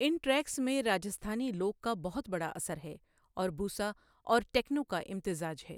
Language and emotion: Urdu, neutral